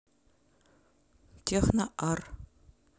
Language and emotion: Russian, neutral